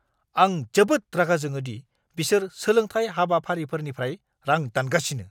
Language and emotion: Bodo, angry